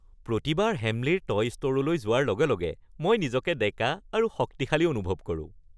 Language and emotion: Assamese, happy